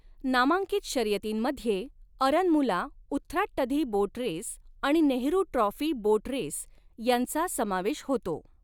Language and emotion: Marathi, neutral